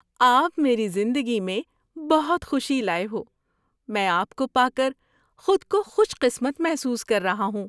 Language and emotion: Urdu, happy